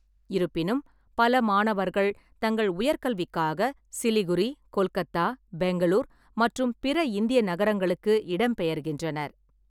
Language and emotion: Tamil, neutral